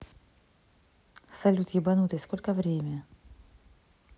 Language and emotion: Russian, neutral